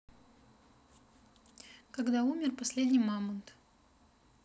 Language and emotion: Russian, neutral